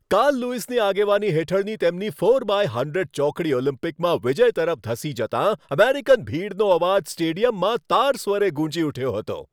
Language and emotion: Gujarati, happy